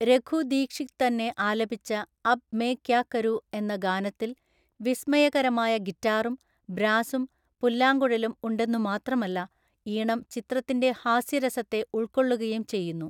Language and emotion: Malayalam, neutral